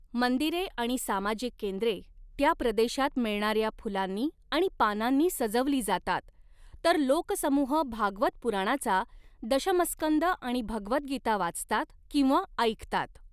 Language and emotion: Marathi, neutral